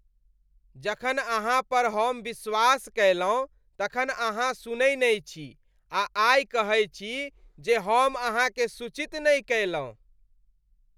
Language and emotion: Maithili, disgusted